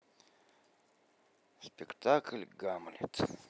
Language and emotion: Russian, sad